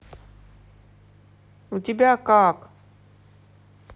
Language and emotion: Russian, angry